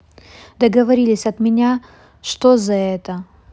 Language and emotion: Russian, neutral